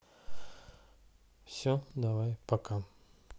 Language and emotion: Russian, sad